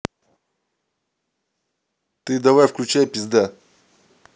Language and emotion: Russian, angry